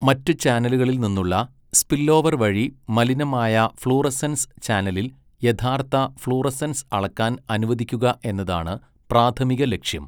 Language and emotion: Malayalam, neutral